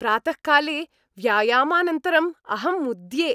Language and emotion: Sanskrit, happy